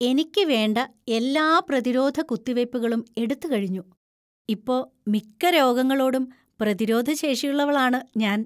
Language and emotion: Malayalam, happy